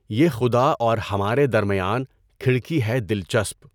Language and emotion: Urdu, neutral